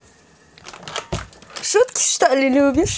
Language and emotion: Russian, positive